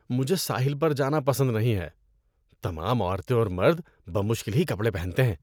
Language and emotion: Urdu, disgusted